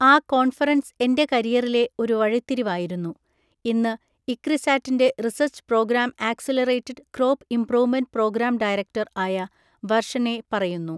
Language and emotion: Malayalam, neutral